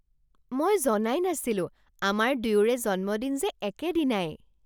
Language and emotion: Assamese, surprised